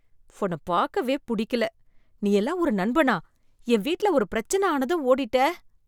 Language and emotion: Tamil, disgusted